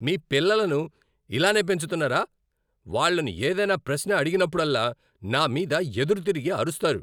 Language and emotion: Telugu, angry